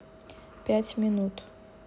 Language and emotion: Russian, neutral